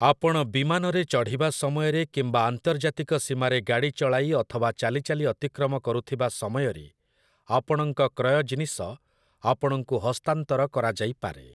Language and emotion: Odia, neutral